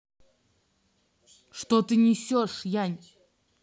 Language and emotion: Russian, angry